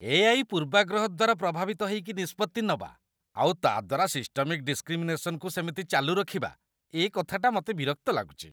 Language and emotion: Odia, disgusted